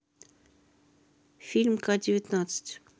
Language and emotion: Russian, neutral